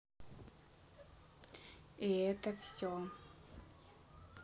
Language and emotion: Russian, neutral